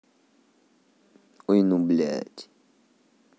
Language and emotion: Russian, angry